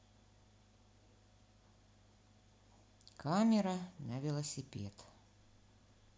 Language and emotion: Russian, neutral